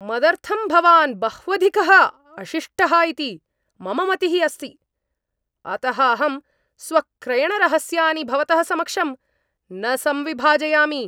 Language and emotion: Sanskrit, angry